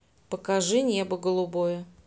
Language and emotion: Russian, neutral